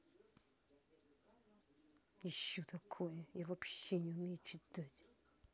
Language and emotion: Russian, angry